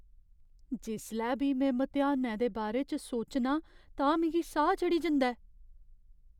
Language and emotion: Dogri, fearful